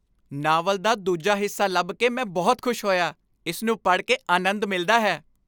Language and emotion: Punjabi, happy